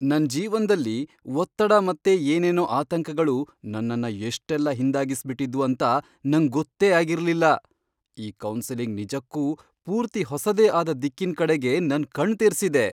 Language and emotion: Kannada, surprised